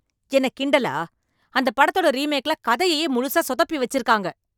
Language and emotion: Tamil, angry